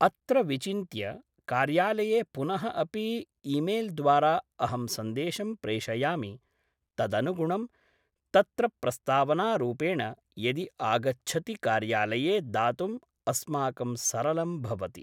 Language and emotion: Sanskrit, neutral